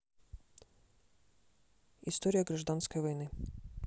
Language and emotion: Russian, neutral